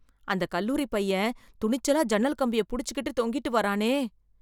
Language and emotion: Tamil, fearful